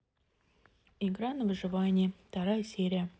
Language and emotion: Russian, neutral